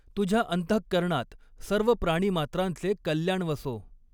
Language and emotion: Marathi, neutral